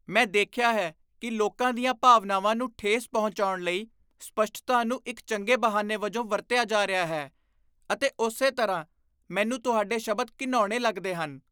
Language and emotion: Punjabi, disgusted